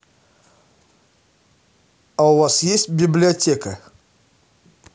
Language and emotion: Russian, neutral